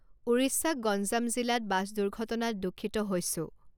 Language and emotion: Assamese, neutral